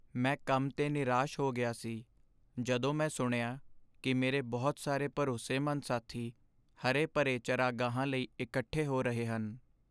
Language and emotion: Punjabi, sad